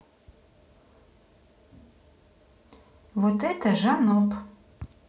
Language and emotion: Russian, neutral